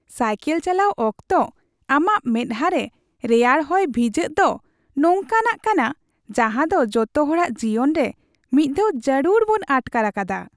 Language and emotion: Santali, happy